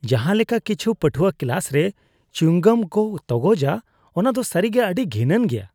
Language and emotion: Santali, disgusted